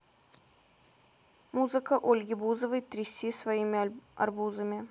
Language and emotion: Russian, neutral